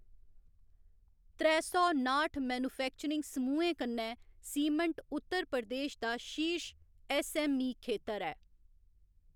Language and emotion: Dogri, neutral